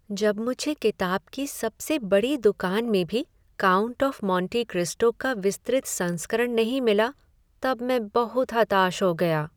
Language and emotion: Hindi, sad